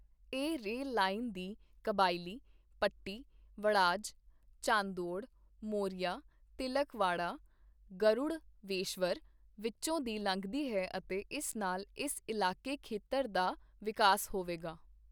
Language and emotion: Punjabi, neutral